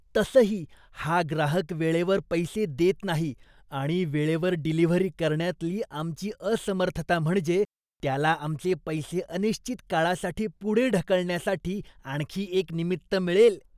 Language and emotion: Marathi, disgusted